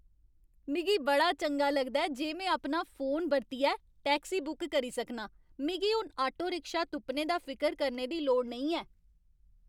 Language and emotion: Dogri, happy